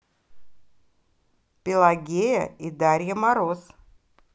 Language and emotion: Russian, positive